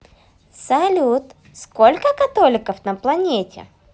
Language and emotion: Russian, positive